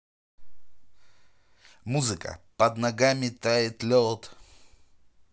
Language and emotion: Russian, positive